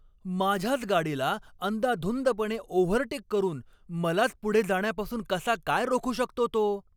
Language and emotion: Marathi, angry